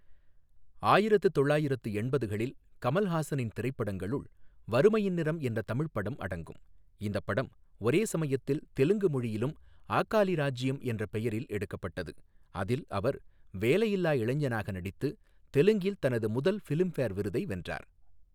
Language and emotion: Tamil, neutral